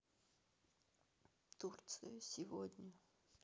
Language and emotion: Russian, sad